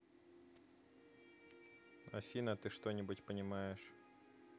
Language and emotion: Russian, neutral